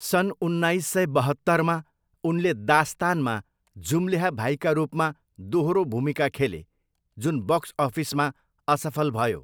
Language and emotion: Nepali, neutral